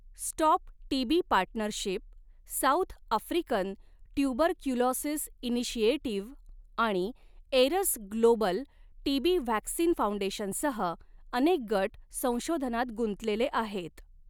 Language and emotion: Marathi, neutral